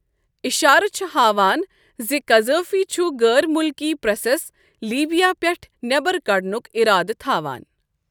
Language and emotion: Kashmiri, neutral